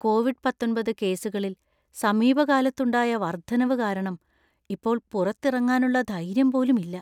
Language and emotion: Malayalam, fearful